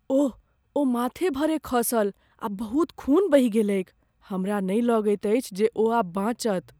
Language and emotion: Maithili, fearful